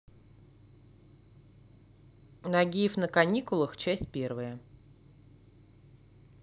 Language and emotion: Russian, neutral